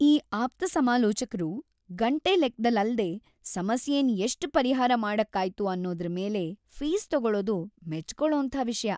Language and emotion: Kannada, happy